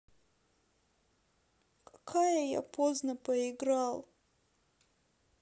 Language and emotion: Russian, sad